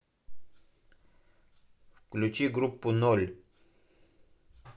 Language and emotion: Russian, neutral